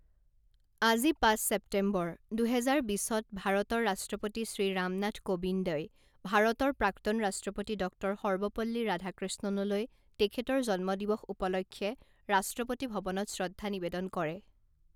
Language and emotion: Assamese, neutral